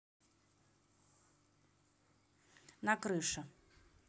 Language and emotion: Russian, neutral